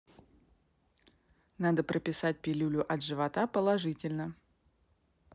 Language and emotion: Russian, neutral